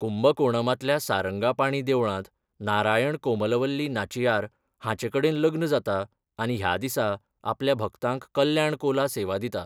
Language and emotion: Goan Konkani, neutral